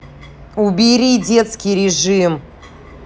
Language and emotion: Russian, angry